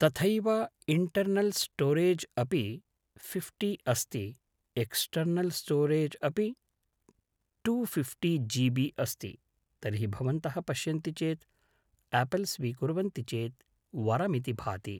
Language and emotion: Sanskrit, neutral